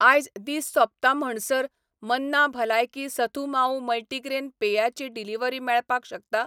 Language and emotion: Goan Konkani, neutral